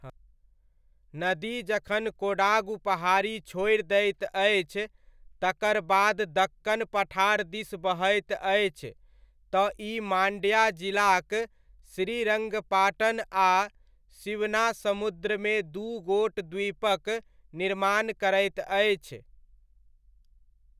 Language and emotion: Maithili, neutral